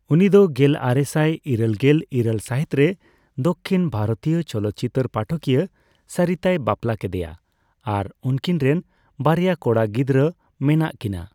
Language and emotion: Santali, neutral